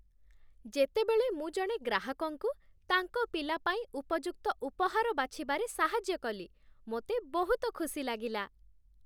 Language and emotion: Odia, happy